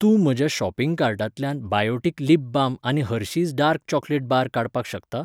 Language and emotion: Goan Konkani, neutral